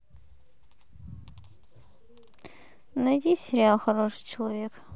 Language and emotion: Russian, neutral